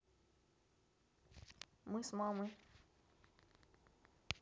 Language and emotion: Russian, neutral